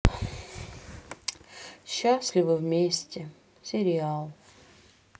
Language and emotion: Russian, sad